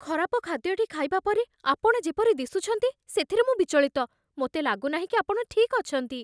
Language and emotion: Odia, fearful